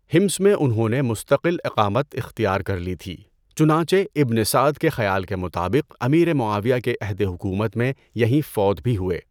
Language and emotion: Urdu, neutral